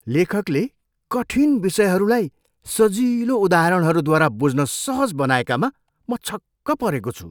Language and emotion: Nepali, surprised